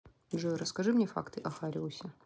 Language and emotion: Russian, neutral